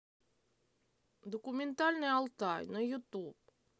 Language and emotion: Russian, neutral